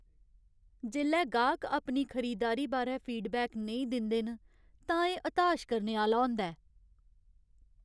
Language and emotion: Dogri, sad